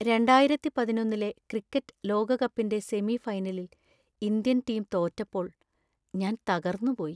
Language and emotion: Malayalam, sad